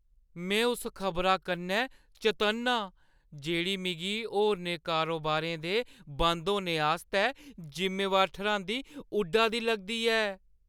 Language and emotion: Dogri, fearful